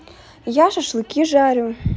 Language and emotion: Russian, neutral